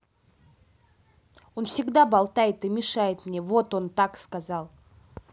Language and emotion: Russian, angry